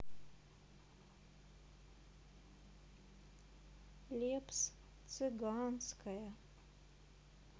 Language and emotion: Russian, sad